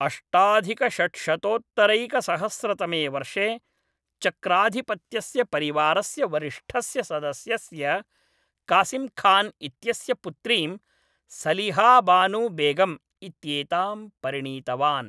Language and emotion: Sanskrit, neutral